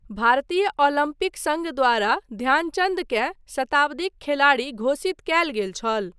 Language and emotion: Maithili, neutral